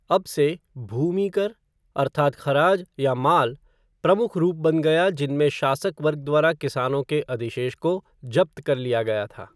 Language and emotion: Hindi, neutral